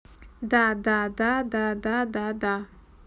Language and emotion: Russian, neutral